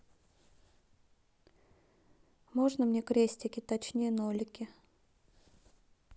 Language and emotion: Russian, neutral